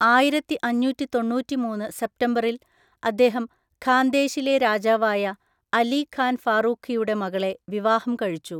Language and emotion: Malayalam, neutral